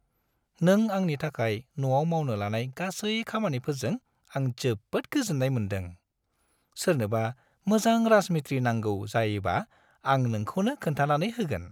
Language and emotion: Bodo, happy